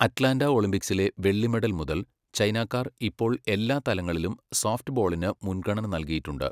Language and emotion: Malayalam, neutral